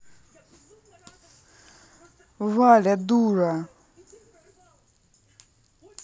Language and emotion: Russian, angry